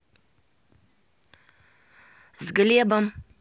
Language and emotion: Russian, neutral